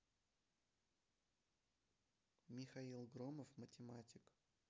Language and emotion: Russian, neutral